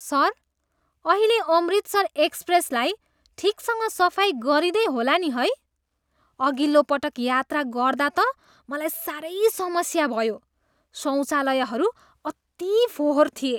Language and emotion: Nepali, disgusted